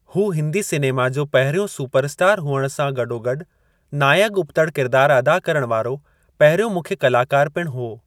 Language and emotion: Sindhi, neutral